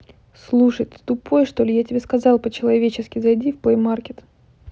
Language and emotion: Russian, angry